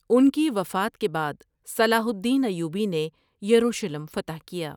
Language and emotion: Urdu, neutral